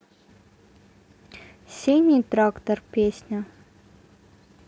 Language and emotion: Russian, neutral